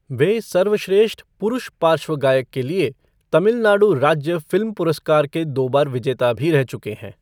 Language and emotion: Hindi, neutral